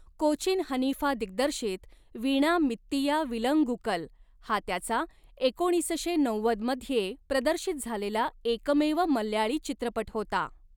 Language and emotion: Marathi, neutral